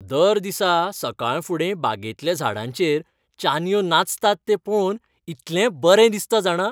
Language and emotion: Goan Konkani, happy